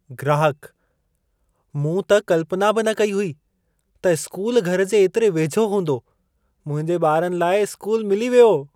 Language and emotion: Sindhi, surprised